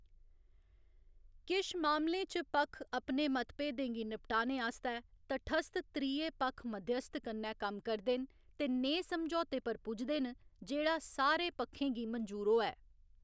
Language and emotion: Dogri, neutral